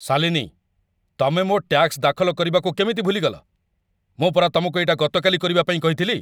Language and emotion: Odia, angry